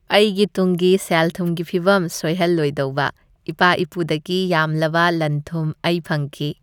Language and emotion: Manipuri, happy